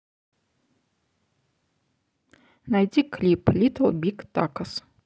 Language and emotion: Russian, neutral